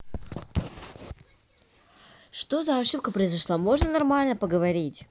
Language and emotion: Russian, angry